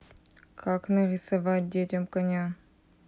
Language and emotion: Russian, neutral